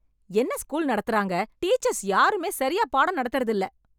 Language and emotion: Tamil, angry